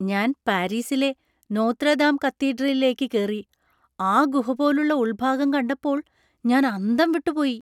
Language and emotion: Malayalam, surprised